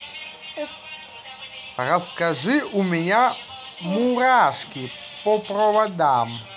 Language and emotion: Russian, positive